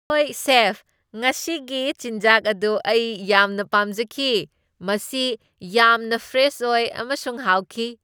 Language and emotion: Manipuri, happy